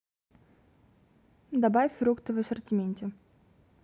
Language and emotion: Russian, neutral